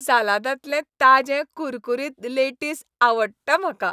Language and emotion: Goan Konkani, happy